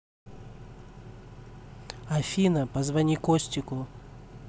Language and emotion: Russian, neutral